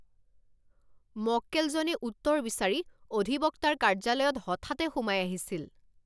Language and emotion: Assamese, angry